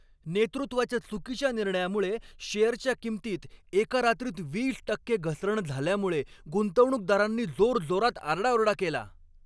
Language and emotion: Marathi, angry